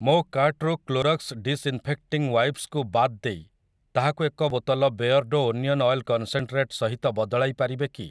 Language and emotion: Odia, neutral